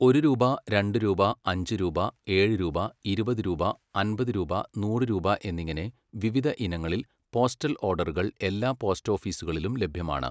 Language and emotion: Malayalam, neutral